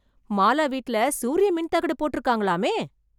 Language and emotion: Tamil, surprised